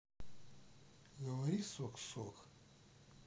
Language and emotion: Russian, neutral